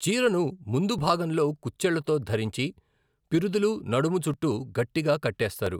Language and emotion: Telugu, neutral